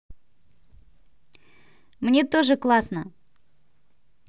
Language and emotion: Russian, positive